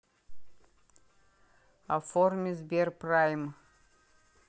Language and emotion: Russian, neutral